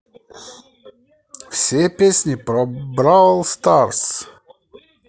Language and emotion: Russian, positive